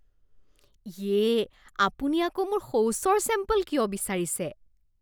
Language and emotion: Assamese, disgusted